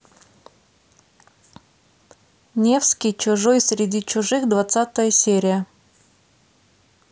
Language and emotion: Russian, neutral